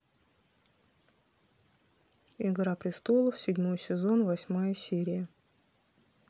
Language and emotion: Russian, neutral